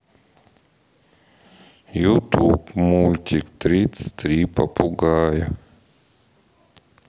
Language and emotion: Russian, sad